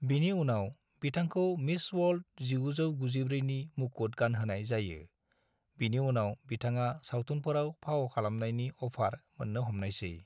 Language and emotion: Bodo, neutral